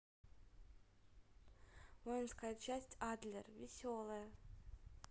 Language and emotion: Russian, neutral